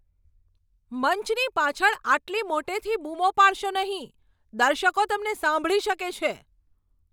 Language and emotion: Gujarati, angry